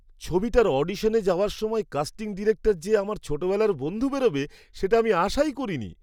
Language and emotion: Bengali, surprised